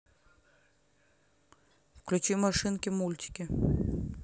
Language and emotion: Russian, neutral